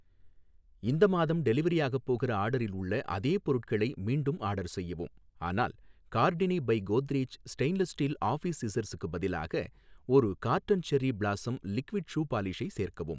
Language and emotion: Tamil, neutral